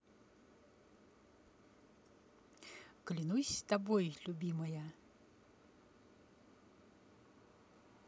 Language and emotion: Russian, neutral